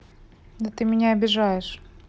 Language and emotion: Russian, neutral